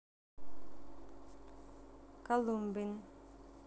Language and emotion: Russian, neutral